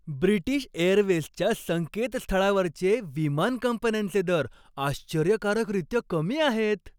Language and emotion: Marathi, happy